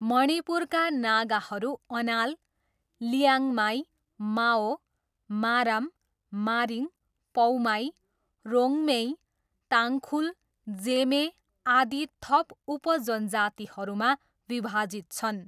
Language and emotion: Nepali, neutral